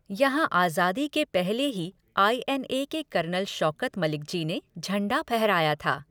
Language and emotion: Hindi, neutral